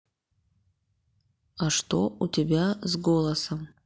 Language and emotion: Russian, neutral